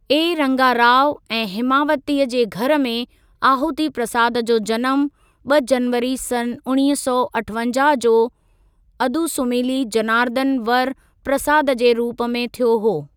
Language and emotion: Sindhi, neutral